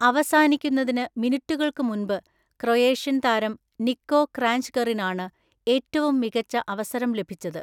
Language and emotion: Malayalam, neutral